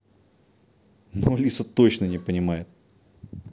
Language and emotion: Russian, neutral